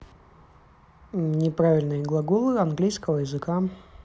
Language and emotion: Russian, neutral